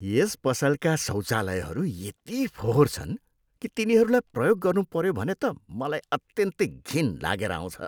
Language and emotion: Nepali, disgusted